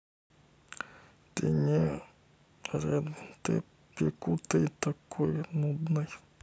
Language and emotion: Russian, neutral